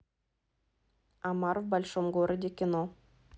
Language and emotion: Russian, neutral